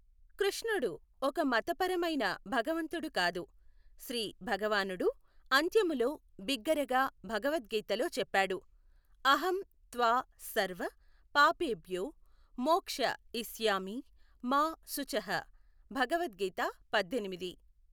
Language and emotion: Telugu, neutral